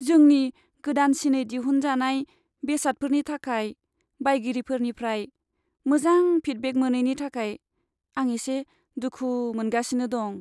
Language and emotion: Bodo, sad